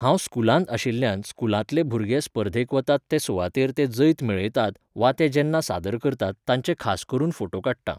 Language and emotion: Goan Konkani, neutral